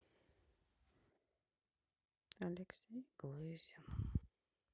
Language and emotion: Russian, sad